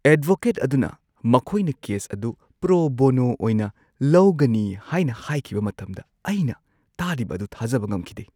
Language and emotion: Manipuri, surprised